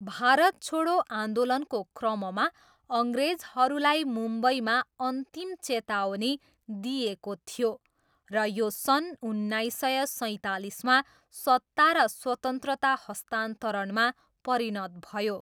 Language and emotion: Nepali, neutral